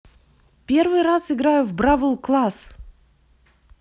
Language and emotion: Russian, positive